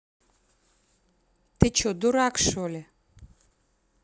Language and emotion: Russian, angry